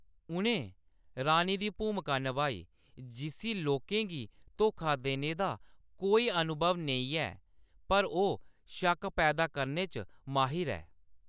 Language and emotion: Dogri, neutral